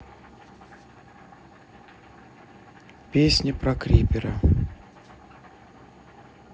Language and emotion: Russian, neutral